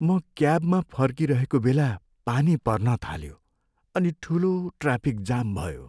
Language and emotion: Nepali, sad